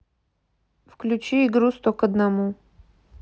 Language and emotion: Russian, neutral